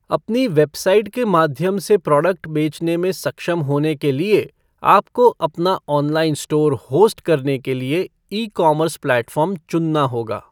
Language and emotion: Hindi, neutral